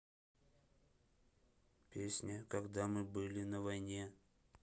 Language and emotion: Russian, neutral